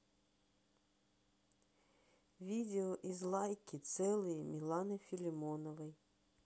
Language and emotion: Russian, neutral